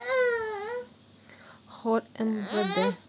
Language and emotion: Russian, neutral